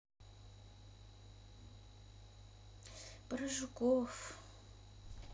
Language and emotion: Russian, sad